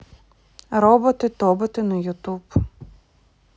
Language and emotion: Russian, neutral